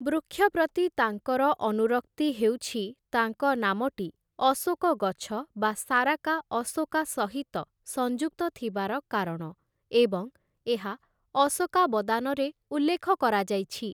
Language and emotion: Odia, neutral